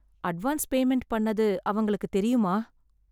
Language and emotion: Tamil, sad